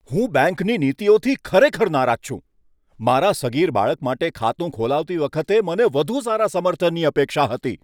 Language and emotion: Gujarati, angry